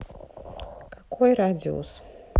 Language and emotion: Russian, neutral